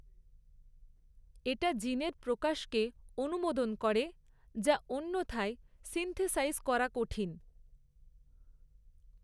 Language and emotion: Bengali, neutral